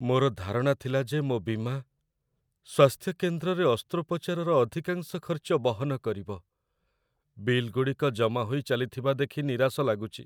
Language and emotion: Odia, sad